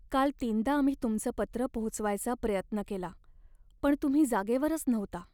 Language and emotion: Marathi, sad